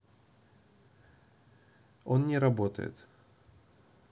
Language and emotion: Russian, neutral